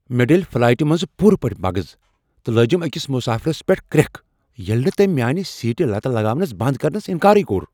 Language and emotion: Kashmiri, angry